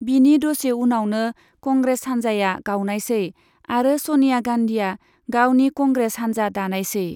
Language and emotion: Bodo, neutral